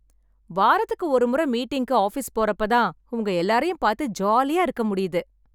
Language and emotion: Tamil, happy